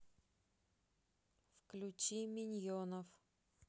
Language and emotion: Russian, neutral